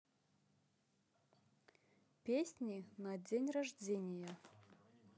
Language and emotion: Russian, neutral